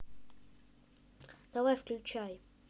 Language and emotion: Russian, neutral